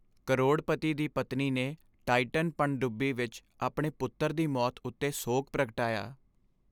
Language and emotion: Punjabi, sad